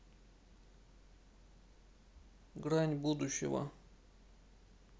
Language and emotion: Russian, sad